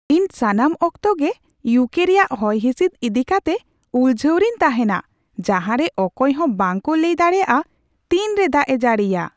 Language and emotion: Santali, surprised